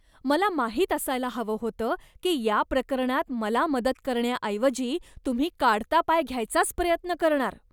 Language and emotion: Marathi, disgusted